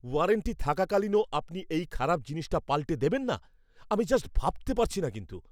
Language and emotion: Bengali, angry